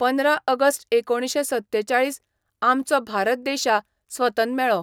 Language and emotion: Goan Konkani, neutral